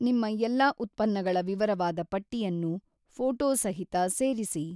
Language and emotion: Kannada, neutral